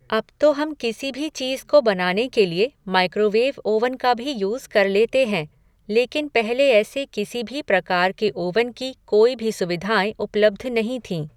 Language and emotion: Hindi, neutral